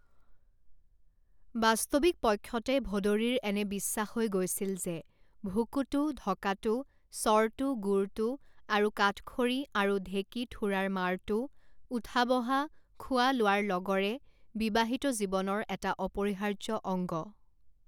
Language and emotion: Assamese, neutral